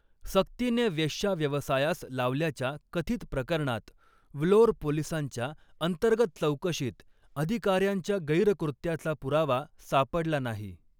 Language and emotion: Marathi, neutral